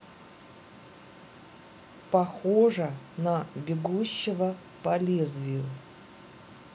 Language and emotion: Russian, neutral